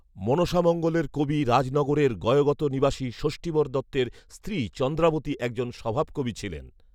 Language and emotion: Bengali, neutral